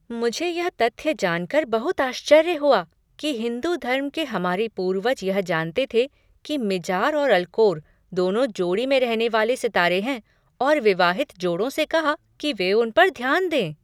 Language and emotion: Hindi, surprised